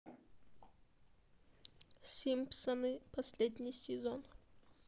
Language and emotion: Russian, sad